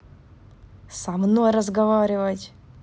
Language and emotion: Russian, angry